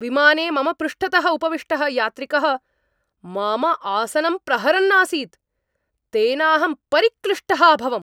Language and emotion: Sanskrit, angry